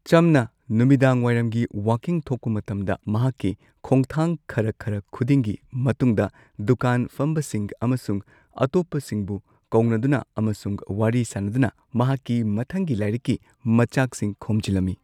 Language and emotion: Manipuri, neutral